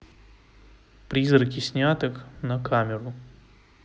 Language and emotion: Russian, neutral